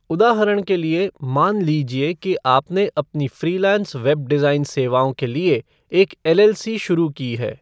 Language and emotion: Hindi, neutral